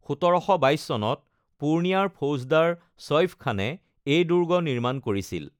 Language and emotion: Assamese, neutral